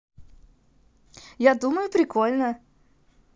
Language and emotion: Russian, positive